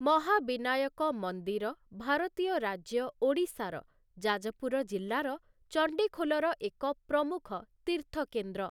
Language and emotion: Odia, neutral